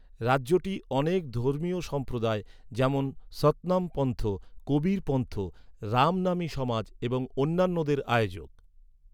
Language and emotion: Bengali, neutral